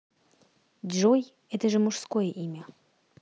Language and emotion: Russian, neutral